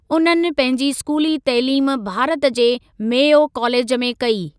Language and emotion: Sindhi, neutral